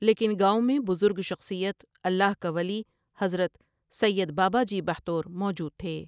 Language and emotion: Urdu, neutral